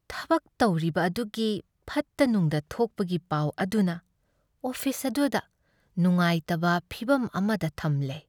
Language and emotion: Manipuri, sad